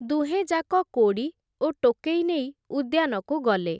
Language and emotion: Odia, neutral